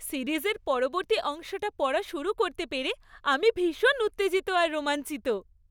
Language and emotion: Bengali, happy